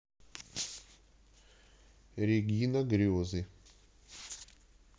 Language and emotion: Russian, neutral